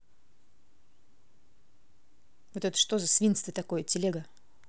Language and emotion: Russian, angry